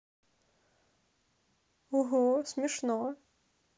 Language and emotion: Russian, neutral